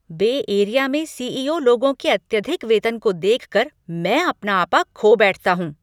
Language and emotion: Hindi, angry